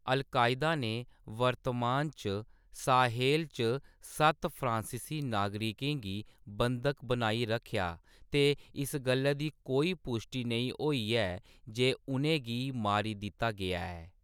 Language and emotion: Dogri, neutral